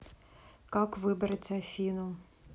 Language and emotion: Russian, neutral